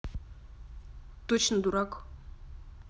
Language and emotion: Russian, neutral